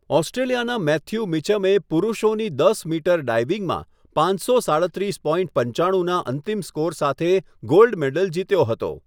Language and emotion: Gujarati, neutral